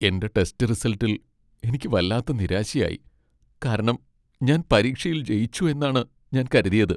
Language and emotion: Malayalam, sad